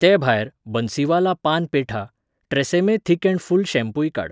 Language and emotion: Goan Konkani, neutral